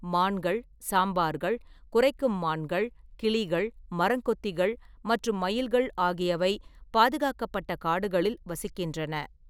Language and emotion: Tamil, neutral